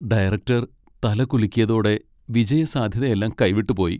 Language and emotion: Malayalam, sad